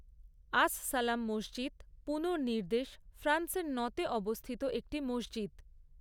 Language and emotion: Bengali, neutral